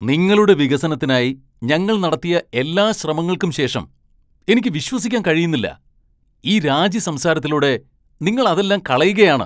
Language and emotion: Malayalam, angry